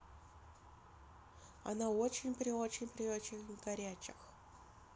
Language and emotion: Russian, neutral